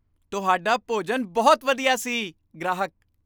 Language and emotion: Punjabi, happy